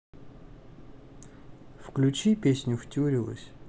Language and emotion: Russian, neutral